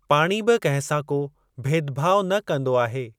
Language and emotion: Sindhi, neutral